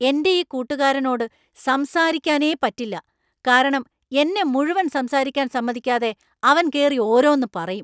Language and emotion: Malayalam, angry